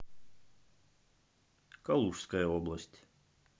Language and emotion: Russian, neutral